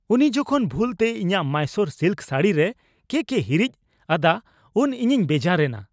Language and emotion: Santali, angry